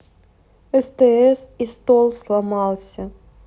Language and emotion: Russian, sad